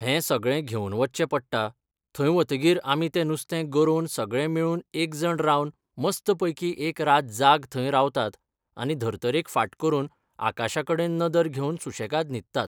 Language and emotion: Goan Konkani, neutral